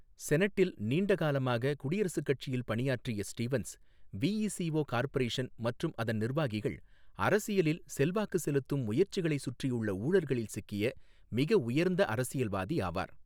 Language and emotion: Tamil, neutral